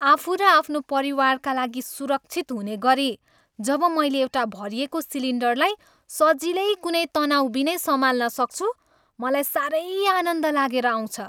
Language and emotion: Nepali, happy